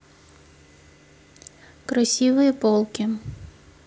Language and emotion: Russian, neutral